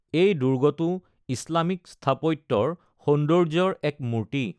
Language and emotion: Assamese, neutral